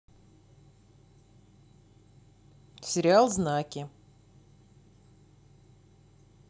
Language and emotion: Russian, neutral